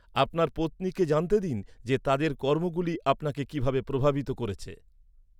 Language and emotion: Bengali, neutral